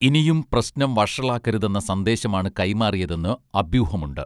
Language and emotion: Malayalam, neutral